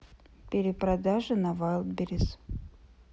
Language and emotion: Russian, sad